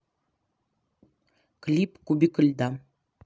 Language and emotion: Russian, neutral